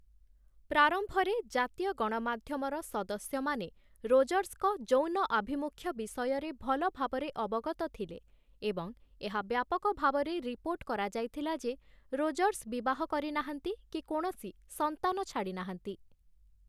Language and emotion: Odia, neutral